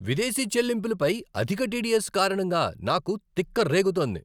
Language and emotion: Telugu, angry